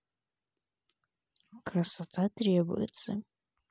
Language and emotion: Russian, neutral